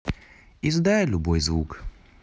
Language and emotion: Russian, neutral